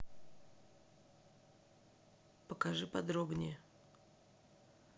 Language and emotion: Russian, neutral